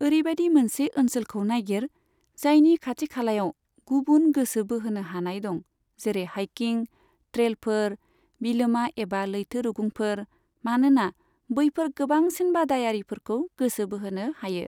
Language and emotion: Bodo, neutral